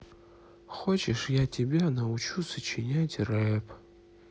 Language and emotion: Russian, sad